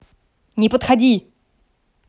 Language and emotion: Russian, angry